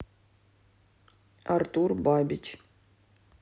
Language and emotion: Russian, neutral